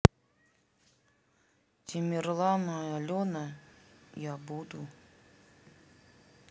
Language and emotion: Russian, sad